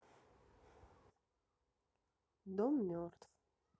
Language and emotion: Russian, sad